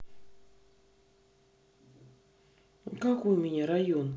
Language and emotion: Russian, neutral